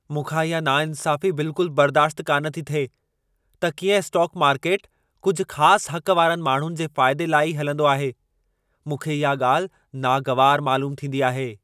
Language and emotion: Sindhi, angry